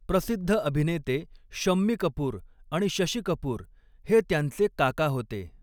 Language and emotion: Marathi, neutral